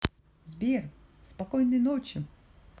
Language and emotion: Russian, positive